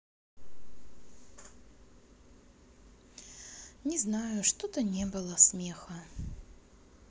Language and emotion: Russian, sad